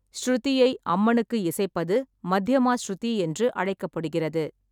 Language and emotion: Tamil, neutral